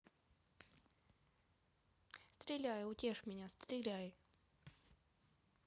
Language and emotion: Russian, neutral